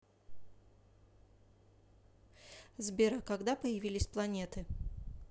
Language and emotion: Russian, neutral